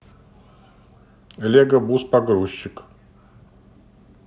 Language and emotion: Russian, neutral